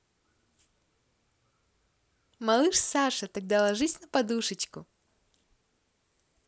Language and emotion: Russian, positive